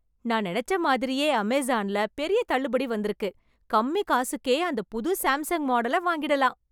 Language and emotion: Tamil, happy